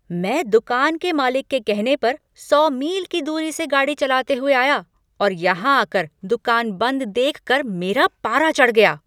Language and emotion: Hindi, angry